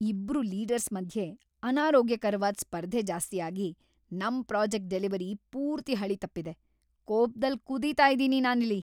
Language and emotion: Kannada, angry